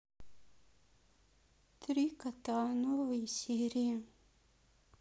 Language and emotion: Russian, sad